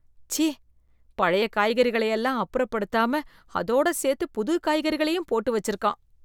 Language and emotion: Tamil, disgusted